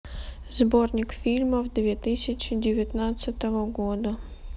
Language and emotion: Russian, neutral